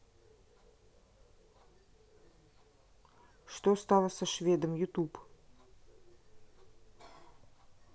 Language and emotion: Russian, neutral